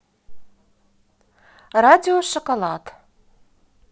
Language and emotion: Russian, positive